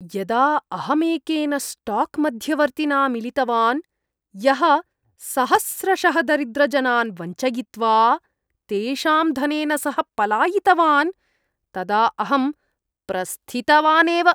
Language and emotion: Sanskrit, disgusted